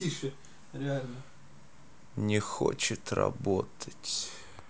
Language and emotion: Russian, sad